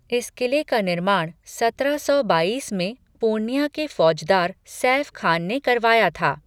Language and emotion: Hindi, neutral